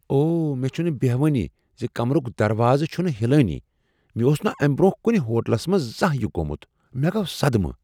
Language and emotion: Kashmiri, surprised